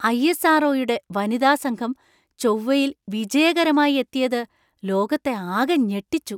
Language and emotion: Malayalam, surprised